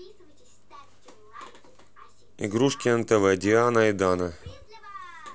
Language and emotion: Russian, neutral